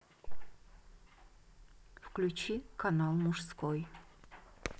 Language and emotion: Russian, neutral